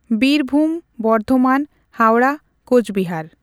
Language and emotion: Santali, neutral